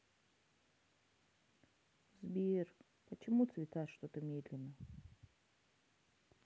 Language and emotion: Russian, sad